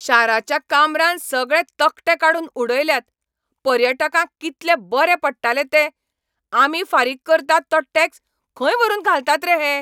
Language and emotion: Goan Konkani, angry